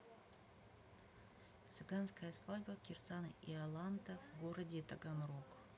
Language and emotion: Russian, neutral